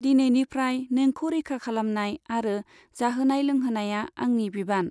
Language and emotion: Bodo, neutral